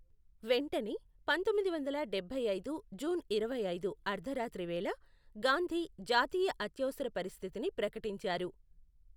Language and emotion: Telugu, neutral